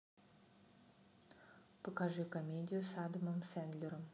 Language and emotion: Russian, neutral